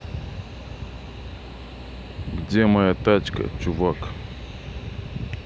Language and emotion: Russian, neutral